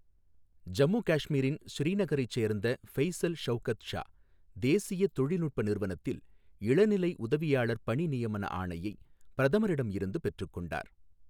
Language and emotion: Tamil, neutral